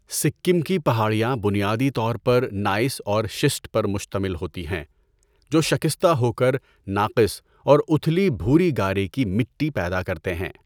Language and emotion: Urdu, neutral